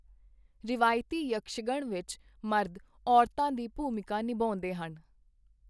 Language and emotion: Punjabi, neutral